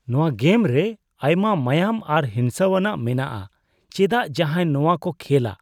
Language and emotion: Santali, disgusted